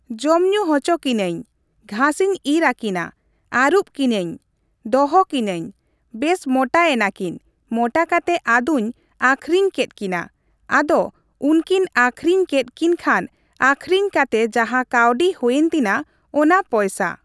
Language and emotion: Santali, neutral